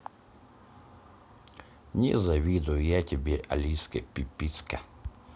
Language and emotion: Russian, neutral